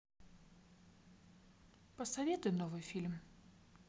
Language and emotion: Russian, neutral